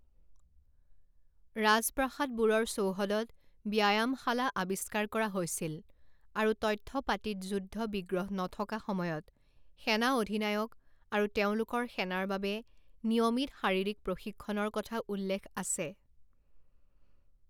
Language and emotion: Assamese, neutral